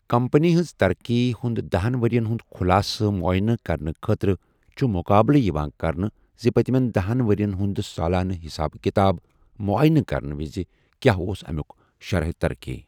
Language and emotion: Kashmiri, neutral